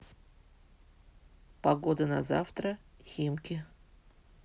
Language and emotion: Russian, neutral